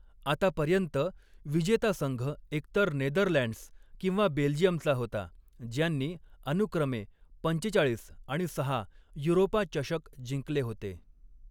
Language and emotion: Marathi, neutral